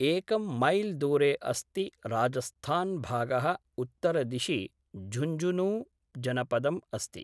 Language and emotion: Sanskrit, neutral